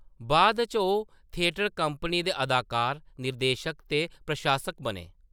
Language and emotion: Dogri, neutral